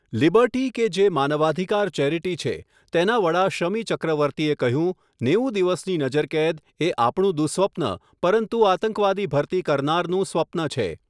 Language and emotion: Gujarati, neutral